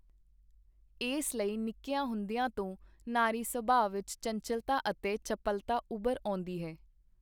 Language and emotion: Punjabi, neutral